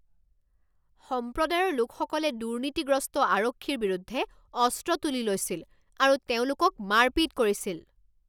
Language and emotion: Assamese, angry